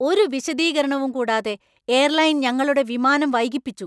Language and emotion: Malayalam, angry